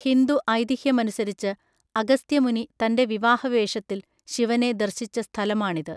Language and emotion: Malayalam, neutral